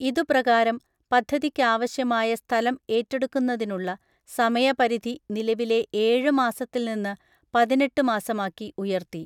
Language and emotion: Malayalam, neutral